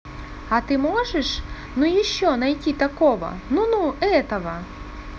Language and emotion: Russian, positive